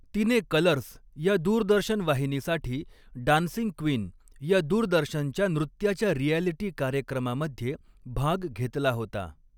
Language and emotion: Marathi, neutral